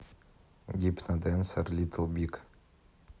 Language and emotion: Russian, neutral